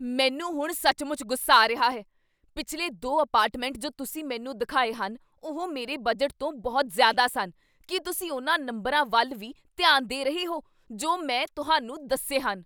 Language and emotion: Punjabi, angry